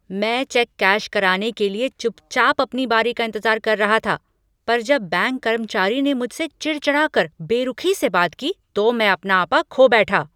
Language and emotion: Hindi, angry